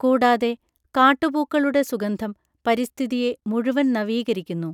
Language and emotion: Malayalam, neutral